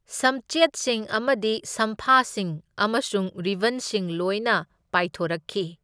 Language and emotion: Manipuri, neutral